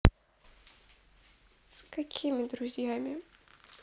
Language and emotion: Russian, sad